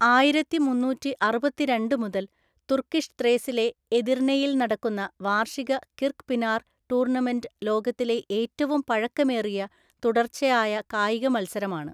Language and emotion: Malayalam, neutral